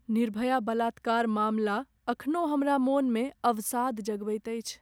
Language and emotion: Maithili, sad